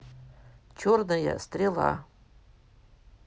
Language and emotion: Russian, neutral